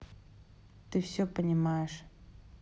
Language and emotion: Russian, neutral